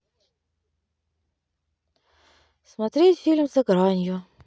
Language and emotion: Russian, neutral